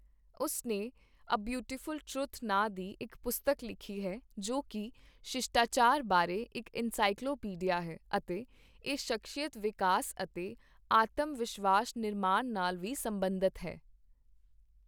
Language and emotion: Punjabi, neutral